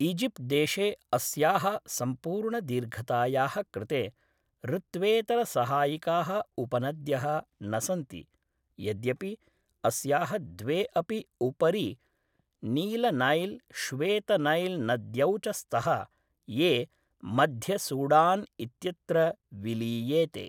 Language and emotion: Sanskrit, neutral